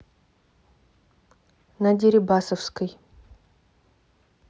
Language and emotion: Russian, neutral